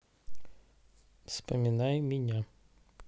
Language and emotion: Russian, neutral